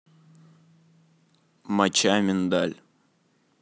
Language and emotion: Russian, neutral